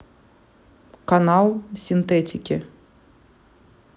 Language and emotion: Russian, neutral